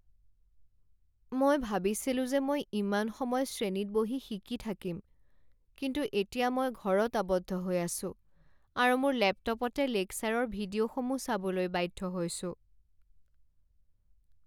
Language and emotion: Assamese, sad